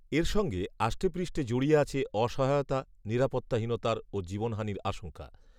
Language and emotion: Bengali, neutral